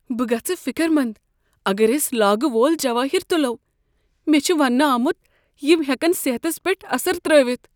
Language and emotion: Kashmiri, fearful